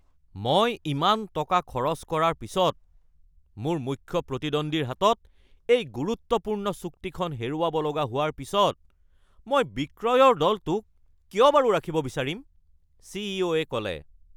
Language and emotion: Assamese, angry